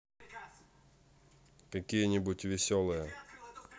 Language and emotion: Russian, neutral